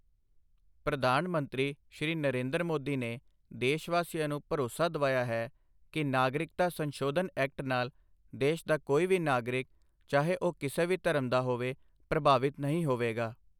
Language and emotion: Punjabi, neutral